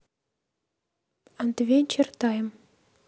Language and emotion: Russian, neutral